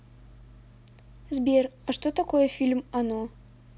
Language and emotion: Russian, neutral